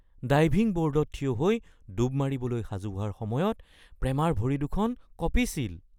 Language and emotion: Assamese, fearful